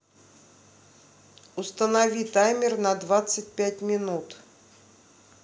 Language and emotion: Russian, neutral